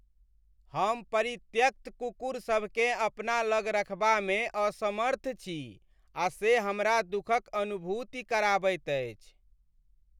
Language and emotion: Maithili, sad